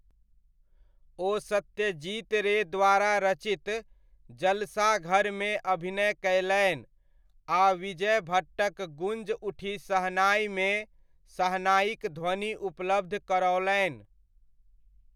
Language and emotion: Maithili, neutral